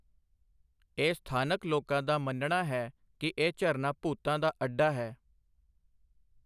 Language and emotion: Punjabi, neutral